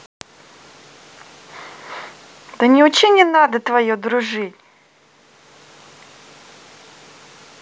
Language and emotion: Russian, angry